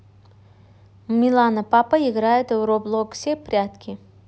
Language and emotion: Russian, neutral